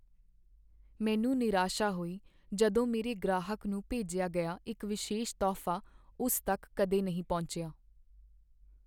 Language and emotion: Punjabi, sad